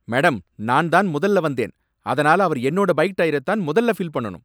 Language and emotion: Tamil, angry